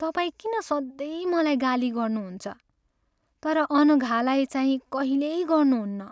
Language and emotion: Nepali, sad